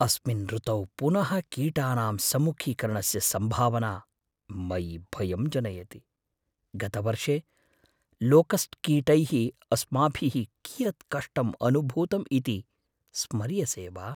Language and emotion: Sanskrit, fearful